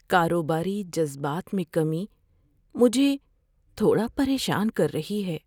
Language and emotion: Urdu, fearful